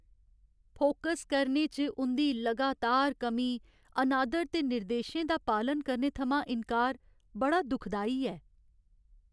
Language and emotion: Dogri, sad